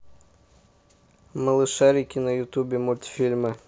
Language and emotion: Russian, neutral